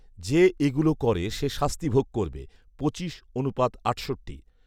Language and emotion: Bengali, neutral